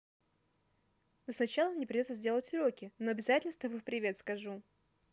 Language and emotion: Russian, positive